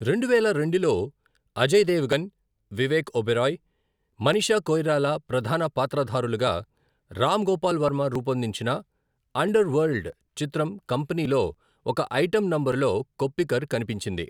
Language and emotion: Telugu, neutral